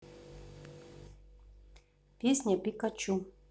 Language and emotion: Russian, neutral